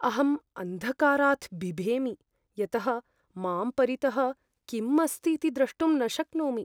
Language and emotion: Sanskrit, fearful